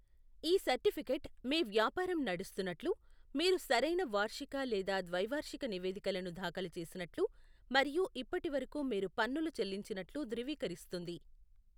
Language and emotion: Telugu, neutral